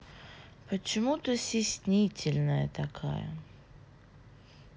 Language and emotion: Russian, neutral